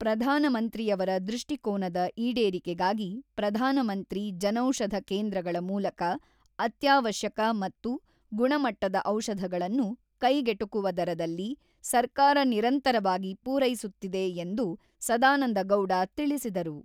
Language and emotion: Kannada, neutral